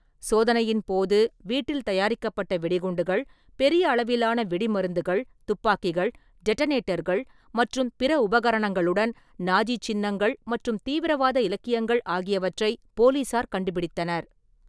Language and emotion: Tamil, neutral